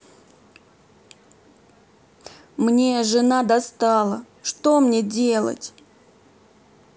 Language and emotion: Russian, sad